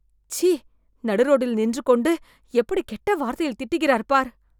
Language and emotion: Tamil, disgusted